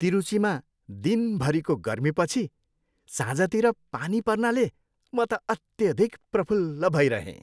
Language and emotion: Nepali, happy